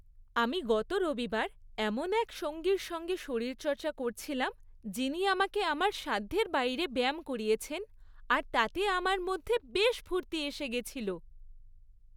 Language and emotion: Bengali, happy